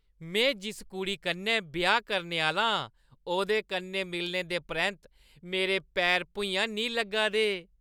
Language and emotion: Dogri, happy